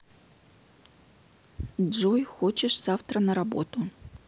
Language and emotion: Russian, neutral